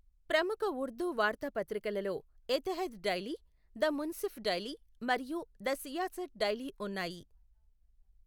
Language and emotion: Telugu, neutral